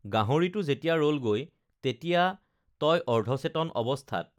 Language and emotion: Assamese, neutral